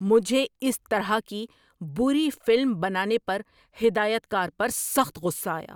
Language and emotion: Urdu, angry